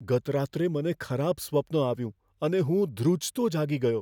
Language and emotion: Gujarati, fearful